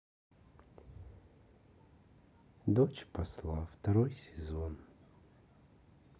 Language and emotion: Russian, sad